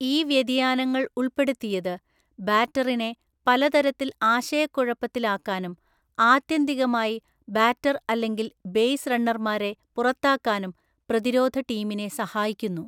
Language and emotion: Malayalam, neutral